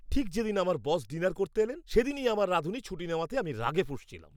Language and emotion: Bengali, angry